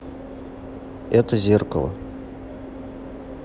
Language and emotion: Russian, neutral